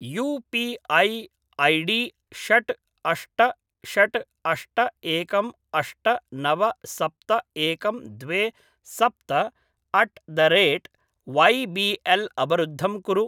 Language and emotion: Sanskrit, neutral